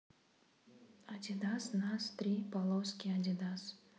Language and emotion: Russian, neutral